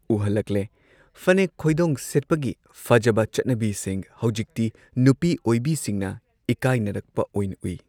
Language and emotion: Manipuri, neutral